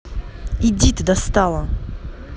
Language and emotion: Russian, angry